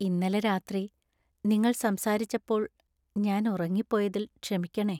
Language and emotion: Malayalam, sad